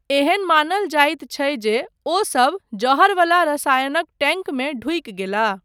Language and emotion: Maithili, neutral